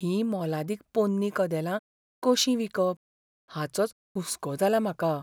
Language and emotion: Goan Konkani, fearful